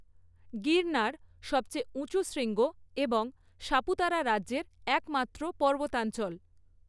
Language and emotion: Bengali, neutral